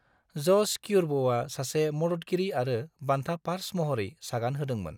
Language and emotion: Bodo, neutral